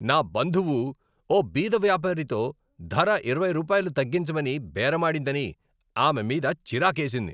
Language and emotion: Telugu, angry